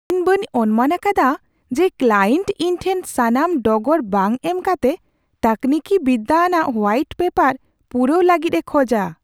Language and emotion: Santali, surprised